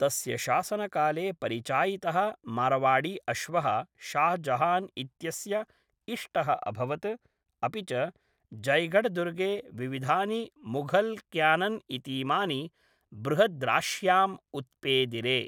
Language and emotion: Sanskrit, neutral